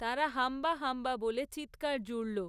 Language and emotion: Bengali, neutral